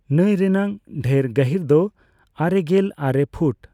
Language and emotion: Santali, neutral